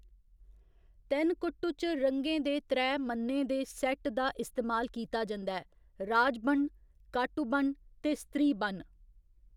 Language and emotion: Dogri, neutral